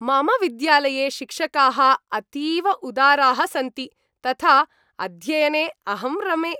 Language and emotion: Sanskrit, happy